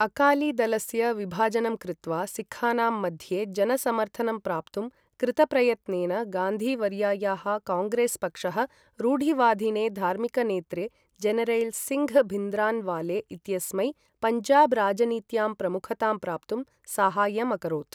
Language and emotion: Sanskrit, neutral